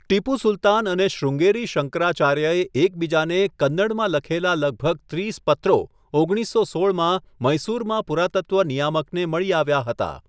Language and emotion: Gujarati, neutral